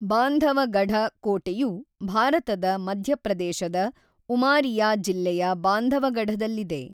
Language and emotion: Kannada, neutral